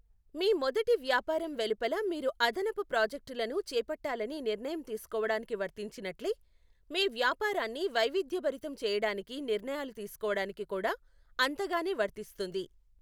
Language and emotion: Telugu, neutral